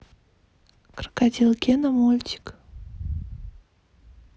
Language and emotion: Russian, neutral